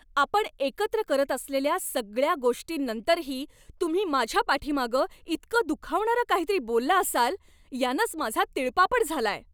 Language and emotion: Marathi, angry